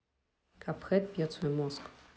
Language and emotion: Russian, neutral